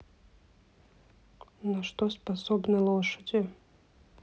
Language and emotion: Russian, neutral